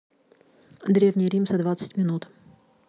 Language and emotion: Russian, neutral